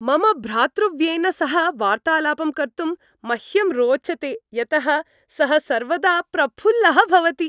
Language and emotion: Sanskrit, happy